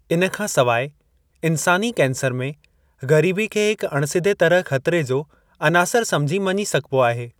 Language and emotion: Sindhi, neutral